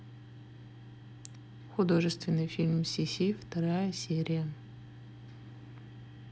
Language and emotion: Russian, neutral